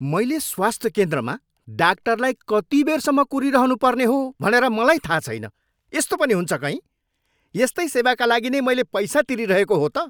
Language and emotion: Nepali, angry